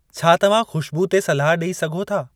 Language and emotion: Sindhi, neutral